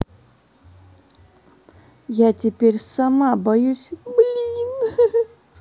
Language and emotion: Russian, sad